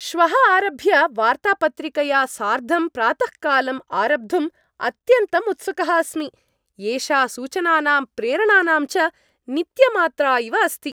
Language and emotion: Sanskrit, happy